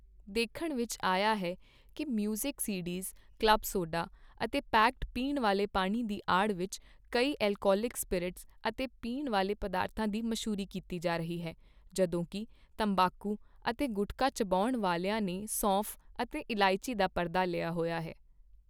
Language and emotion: Punjabi, neutral